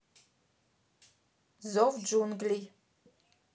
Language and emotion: Russian, neutral